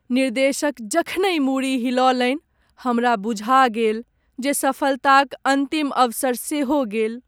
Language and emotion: Maithili, sad